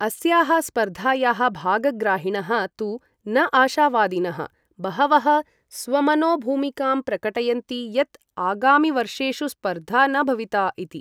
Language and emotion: Sanskrit, neutral